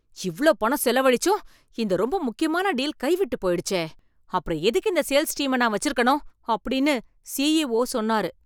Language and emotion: Tamil, angry